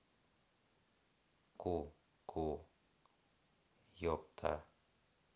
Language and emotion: Russian, neutral